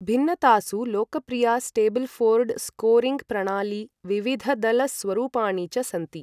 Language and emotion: Sanskrit, neutral